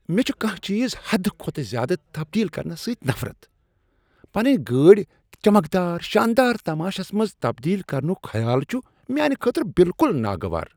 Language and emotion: Kashmiri, disgusted